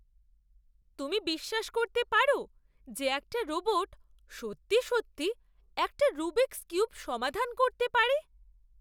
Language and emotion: Bengali, surprised